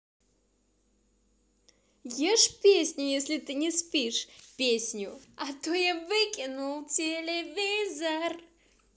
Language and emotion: Russian, positive